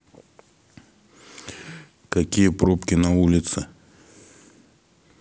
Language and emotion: Russian, neutral